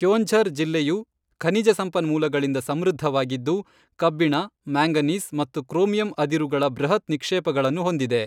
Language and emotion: Kannada, neutral